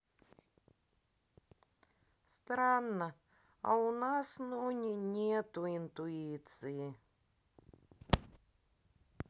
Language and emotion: Russian, sad